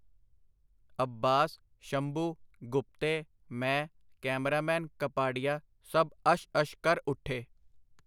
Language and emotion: Punjabi, neutral